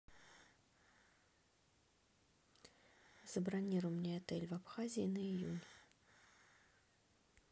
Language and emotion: Russian, neutral